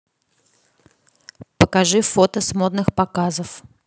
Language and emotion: Russian, neutral